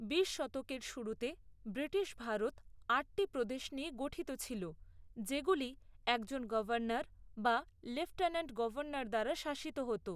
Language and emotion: Bengali, neutral